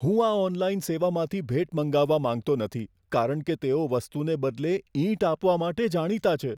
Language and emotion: Gujarati, fearful